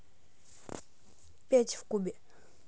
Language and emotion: Russian, neutral